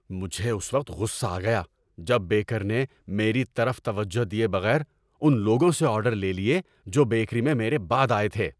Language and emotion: Urdu, angry